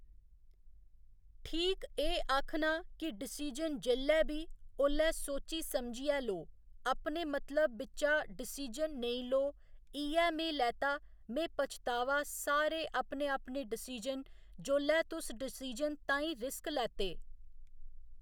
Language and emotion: Dogri, neutral